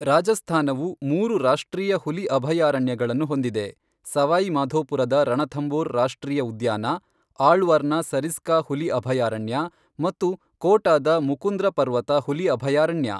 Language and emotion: Kannada, neutral